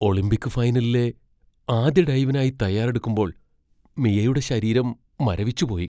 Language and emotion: Malayalam, fearful